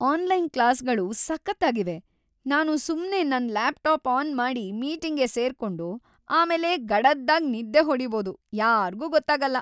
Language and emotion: Kannada, happy